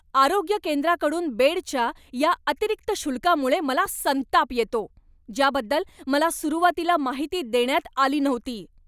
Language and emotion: Marathi, angry